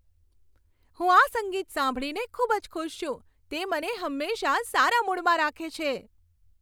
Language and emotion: Gujarati, happy